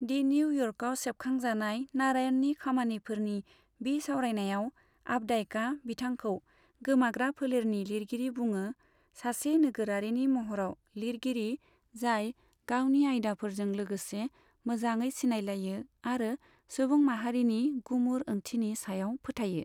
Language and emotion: Bodo, neutral